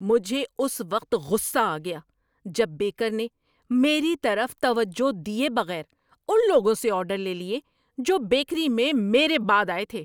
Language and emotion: Urdu, angry